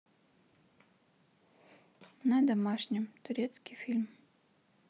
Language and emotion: Russian, neutral